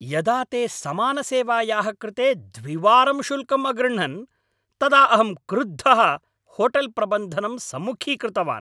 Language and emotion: Sanskrit, angry